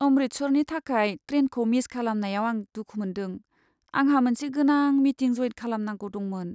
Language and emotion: Bodo, sad